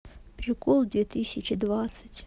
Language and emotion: Russian, sad